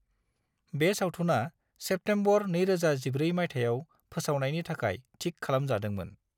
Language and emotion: Bodo, neutral